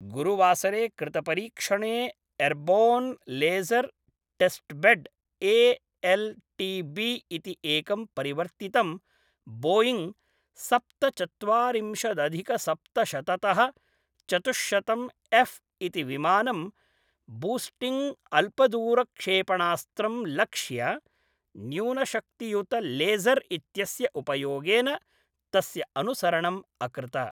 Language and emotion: Sanskrit, neutral